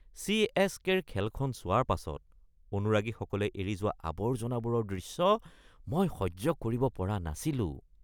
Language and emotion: Assamese, disgusted